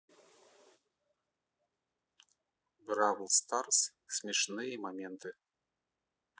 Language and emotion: Russian, neutral